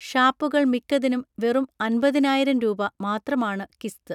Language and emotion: Malayalam, neutral